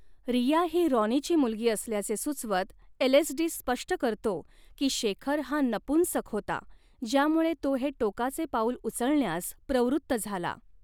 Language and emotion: Marathi, neutral